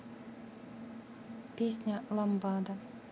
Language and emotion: Russian, neutral